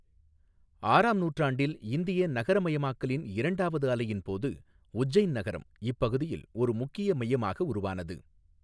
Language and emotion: Tamil, neutral